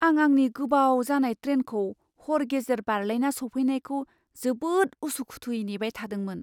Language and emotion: Bodo, fearful